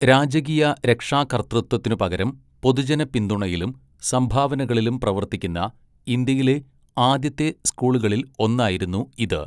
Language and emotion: Malayalam, neutral